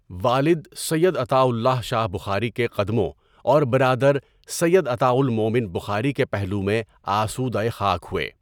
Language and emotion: Urdu, neutral